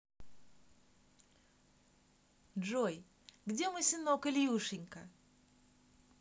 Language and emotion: Russian, positive